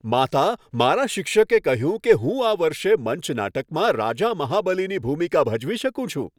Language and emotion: Gujarati, happy